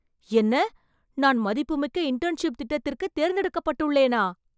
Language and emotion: Tamil, surprised